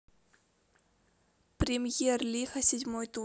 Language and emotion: Russian, neutral